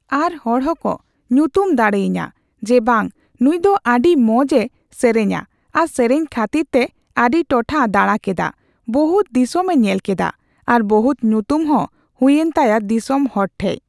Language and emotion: Santali, neutral